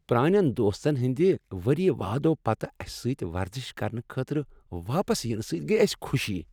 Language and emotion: Kashmiri, happy